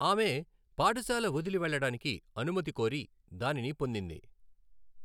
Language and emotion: Telugu, neutral